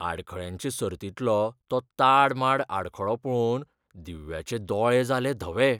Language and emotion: Goan Konkani, fearful